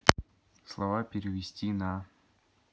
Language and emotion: Russian, neutral